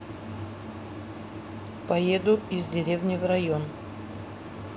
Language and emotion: Russian, neutral